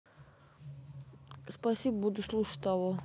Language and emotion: Russian, neutral